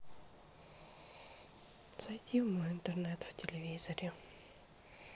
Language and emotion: Russian, sad